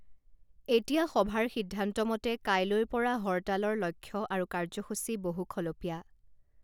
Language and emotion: Assamese, neutral